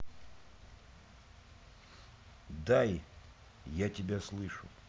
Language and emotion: Russian, neutral